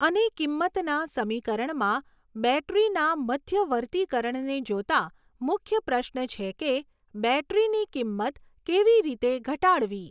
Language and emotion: Gujarati, neutral